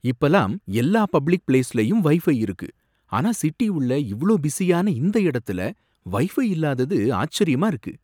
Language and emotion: Tamil, surprised